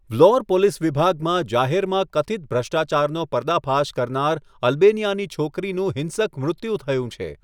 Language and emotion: Gujarati, neutral